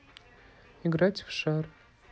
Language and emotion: Russian, neutral